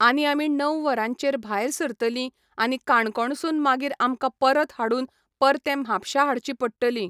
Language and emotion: Goan Konkani, neutral